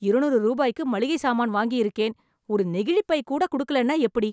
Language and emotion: Tamil, angry